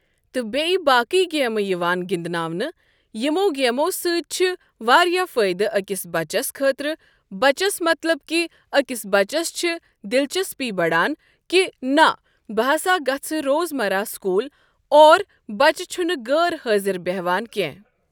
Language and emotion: Kashmiri, neutral